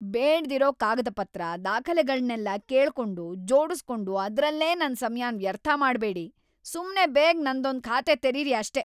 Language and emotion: Kannada, angry